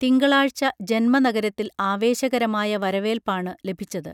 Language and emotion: Malayalam, neutral